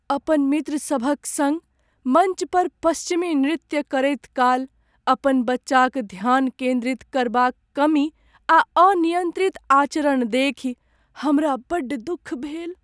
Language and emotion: Maithili, sad